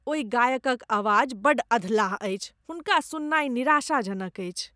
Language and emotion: Maithili, disgusted